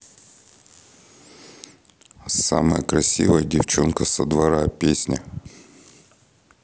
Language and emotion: Russian, neutral